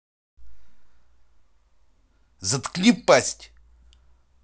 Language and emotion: Russian, angry